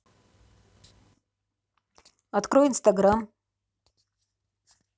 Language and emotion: Russian, neutral